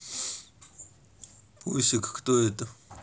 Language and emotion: Russian, neutral